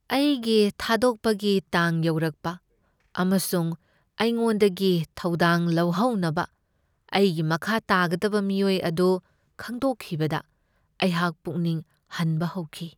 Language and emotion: Manipuri, sad